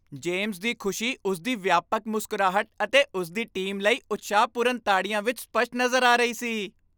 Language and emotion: Punjabi, happy